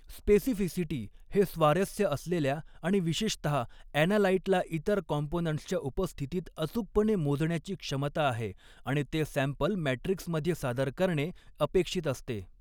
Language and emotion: Marathi, neutral